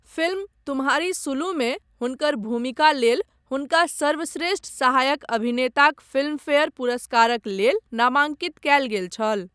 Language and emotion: Maithili, neutral